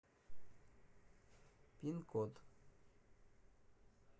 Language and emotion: Russian, neutral